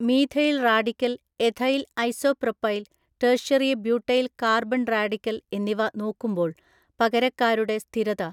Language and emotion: Malayalam, neutral